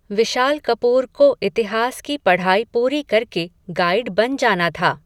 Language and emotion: Hindi, neutral